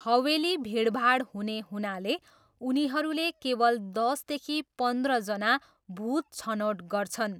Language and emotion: Nepali, neutral